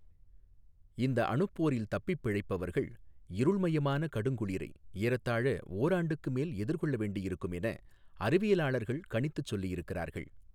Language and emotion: Tamil, neutral